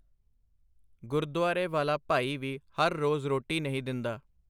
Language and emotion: Punjabi, neutral